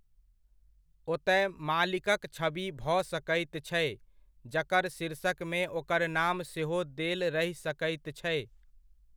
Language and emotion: Maithili, neutral